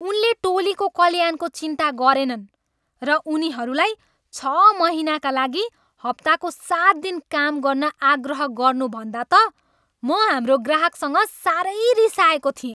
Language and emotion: Nepali, angry